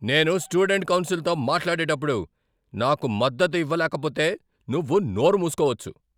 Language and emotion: Telugu, angry